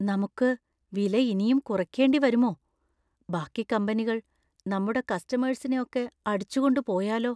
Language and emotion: Malayalam, fearful